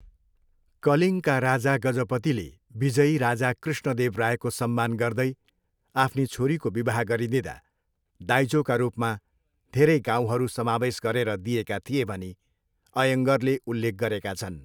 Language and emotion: Nepali, neutral